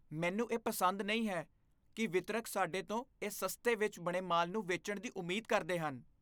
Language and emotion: Punjabi, disgusted